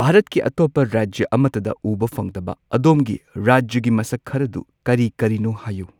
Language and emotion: Manipuri, neutral